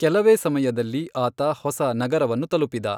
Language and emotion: Kannada, neutral